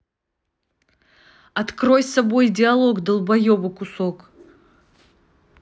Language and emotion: Russian, angry